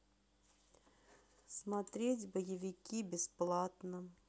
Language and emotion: Russian, sad